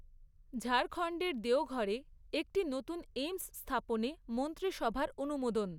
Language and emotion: Bengali, neutral